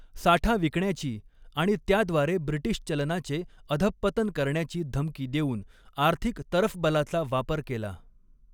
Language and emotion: Marathi, neutral